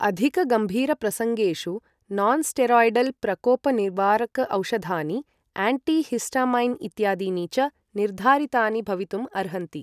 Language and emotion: Sanskrit, neutral